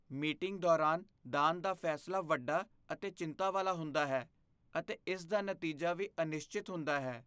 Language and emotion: Punjabi, fearful